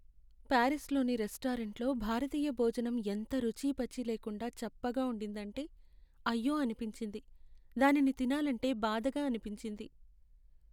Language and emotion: Telugu, sad